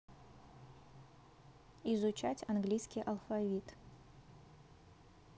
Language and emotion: Russian, neutral